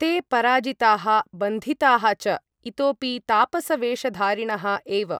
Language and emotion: Sanskrit, neutral